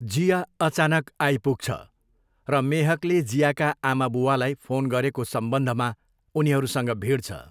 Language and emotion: Nepali, neutral